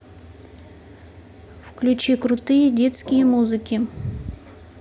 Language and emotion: Russian, neutral